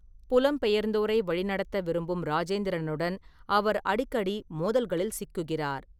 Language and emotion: Tamil, neutral